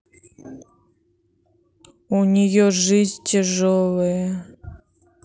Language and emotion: Russian, sad